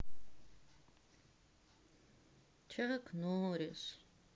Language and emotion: Russian, sad